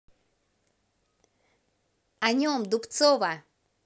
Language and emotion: Russian, positive